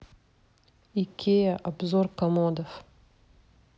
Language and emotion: Russian, neutral